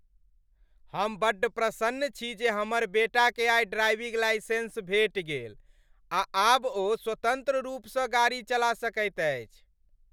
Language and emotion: Maithili, happy